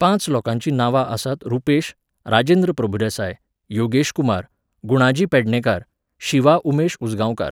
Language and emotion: Goan Konkani, neutral